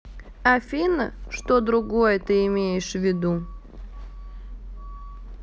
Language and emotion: Russian, neutral